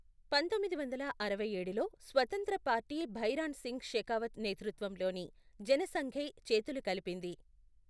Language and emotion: Telugu, neutral